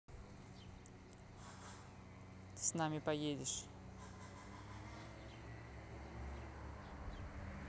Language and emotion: Russian, neutral